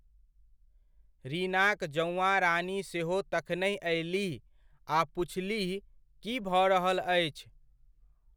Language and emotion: Maithili, neutral